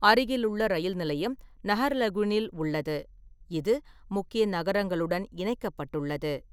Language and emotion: Tamil, neutral